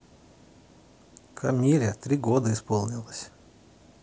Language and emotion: Russian, neutral